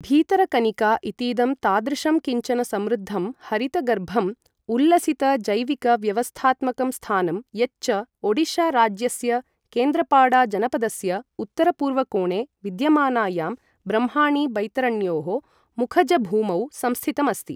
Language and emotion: Sanskrit, neutral